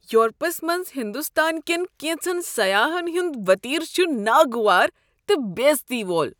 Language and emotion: Kashmiri, disgusted